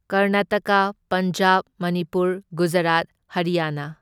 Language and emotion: Manipuri, neutral